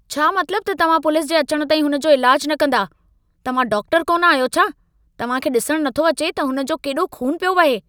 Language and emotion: Sindhi, angry